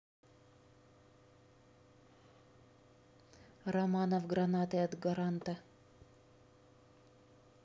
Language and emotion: Russian, neutral